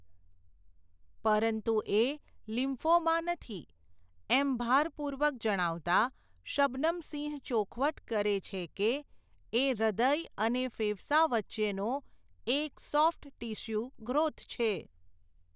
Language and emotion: Gujarati, neutral